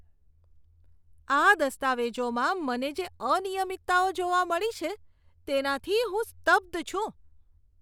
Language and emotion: Gujarati, disgusted